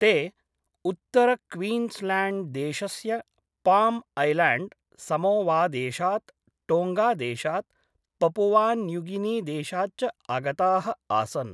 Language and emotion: Sanskrit, neutral